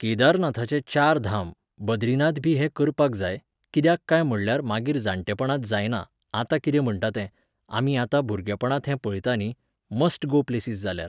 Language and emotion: Goan Konkani, neutral